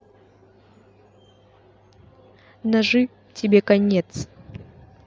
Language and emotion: Russian, angry